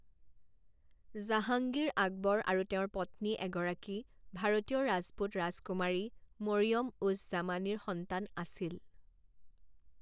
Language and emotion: Assamese, neutral